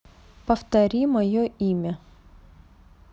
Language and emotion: Russian, neutral